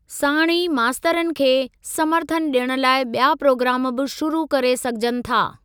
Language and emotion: Sindhi, neutral